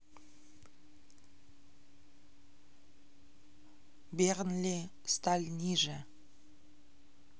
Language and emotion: Russian, neutral